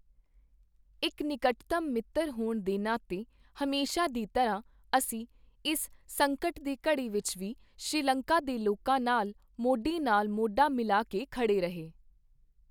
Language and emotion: Punjabi, neutral